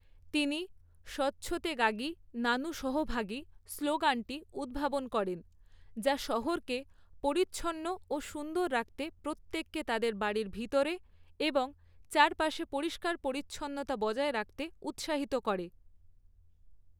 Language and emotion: Bengali, neutral